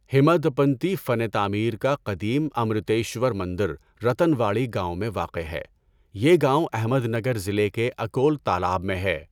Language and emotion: Urdu, neutral